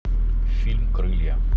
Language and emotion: Russian, neutral